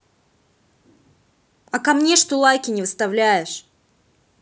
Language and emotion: Russian, angry